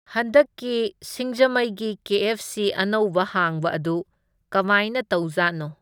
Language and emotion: Manipuri, neutral